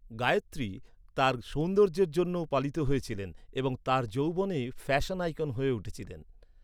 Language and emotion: Bengali, neutral